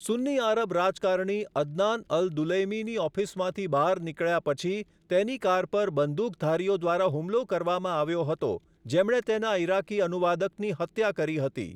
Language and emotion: Gujarati, neutral